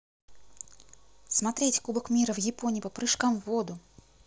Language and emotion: Russian, positive